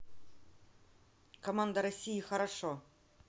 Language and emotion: Russian, neutral